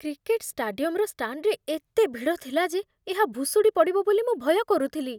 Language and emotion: Odia, fearful